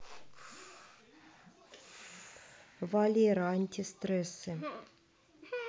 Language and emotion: Russian, neutral